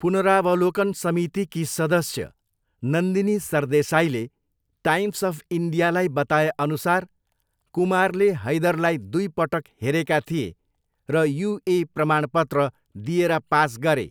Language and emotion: Nepali, neutral